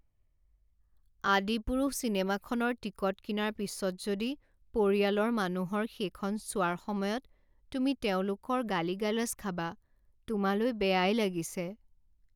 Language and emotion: Assamese, sad